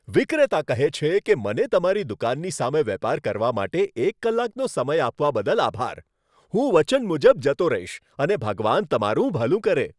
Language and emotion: Gujarati, happy